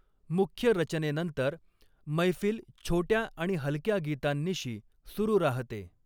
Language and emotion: Marathi, neutral